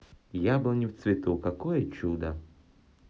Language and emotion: Russian, positive